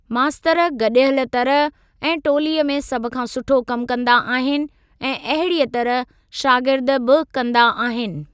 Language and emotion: Sindhi, neutral